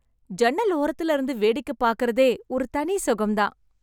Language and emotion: Tamil, happy